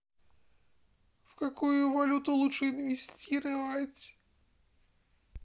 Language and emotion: Russian, sad